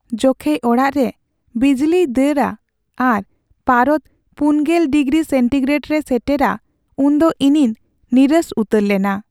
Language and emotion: Santali, sad